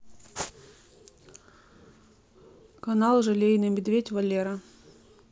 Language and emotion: Russian, neutral